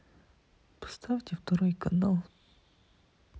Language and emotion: Russian, sad